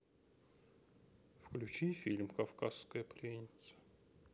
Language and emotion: Russian, sad